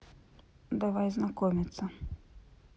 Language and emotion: Russian, neutral